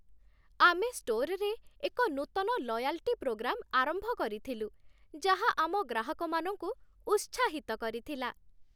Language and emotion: Odia, happy